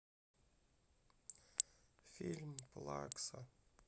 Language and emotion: Russian, sad